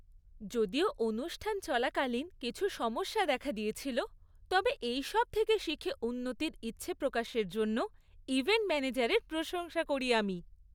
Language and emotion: Bengali, happy